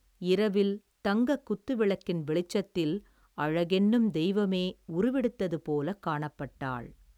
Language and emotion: Tamil, neutral